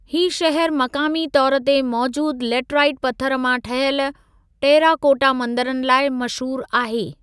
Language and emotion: Sindhi, neutral